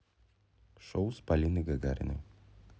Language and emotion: Russian, neutral